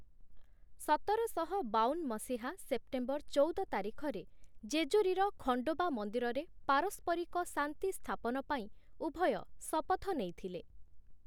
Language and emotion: Odia, neutral